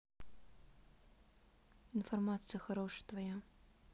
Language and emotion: Russian, neutral